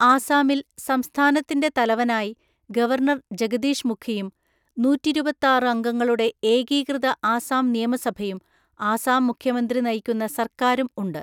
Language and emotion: Malayalam, neutral